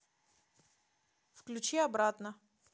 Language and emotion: Russian, neutral